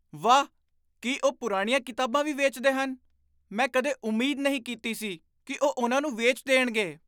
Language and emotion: Punjabi, surprised